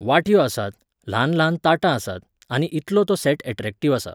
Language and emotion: Goan Konkani, neutral